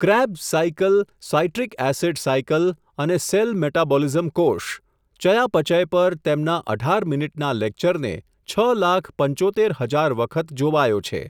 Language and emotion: Gujarati, neutral